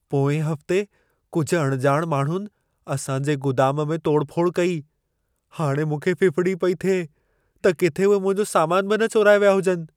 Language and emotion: Sindhi, fearful